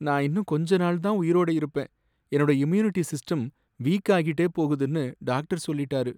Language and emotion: Tamil, sad